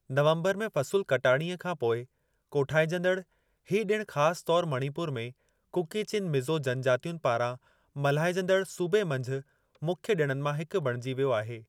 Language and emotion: Sindhi, neutral